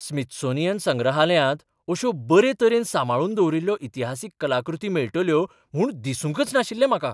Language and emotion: Goan Konkani, surprised